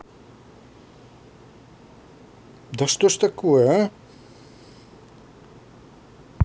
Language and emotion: Russian, angry